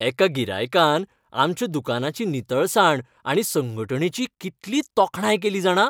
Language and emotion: Goan Konkani, happy